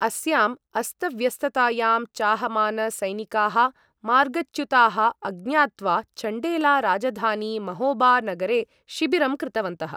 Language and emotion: Sanskrit, neutral